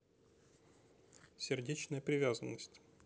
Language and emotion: Russian, neutral